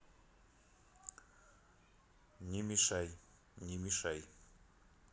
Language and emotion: Russian, neutral